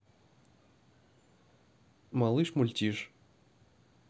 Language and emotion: Russian, neutral